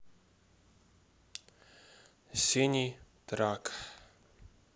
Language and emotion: Russian, neutral